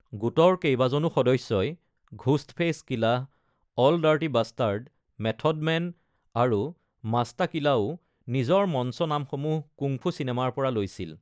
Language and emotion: Assamese, neutral